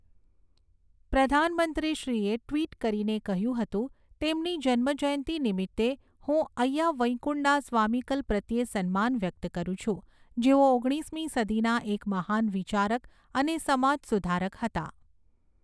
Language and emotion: Gujarati, neutral